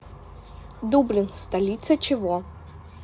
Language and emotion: Russian, neutral